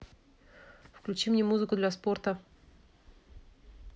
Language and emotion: Russian, neutral